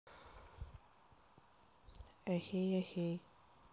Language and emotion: Russian, neutral